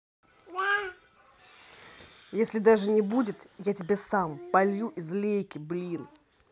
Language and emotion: Russian, angry